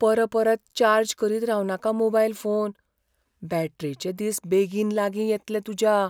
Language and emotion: Goan Konkani, fearful